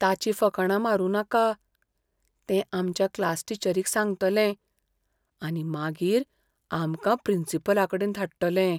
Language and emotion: Goan Konkani, fearful